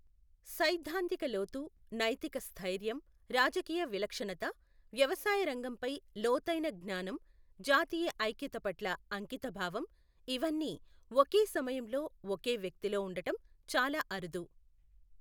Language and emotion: Telugu, neutral